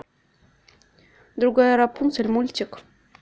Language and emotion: Russian, neutral